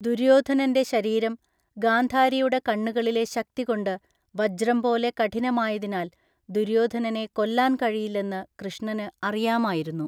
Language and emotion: Malayalam, neutral